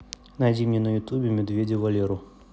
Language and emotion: Russian, neutral